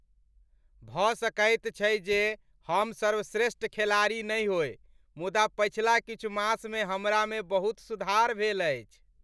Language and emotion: Maithili, happy